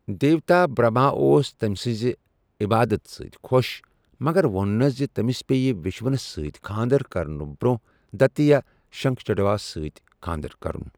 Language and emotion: Kashmiri, neutral